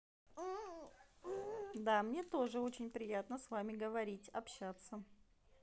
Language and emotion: Russian, positive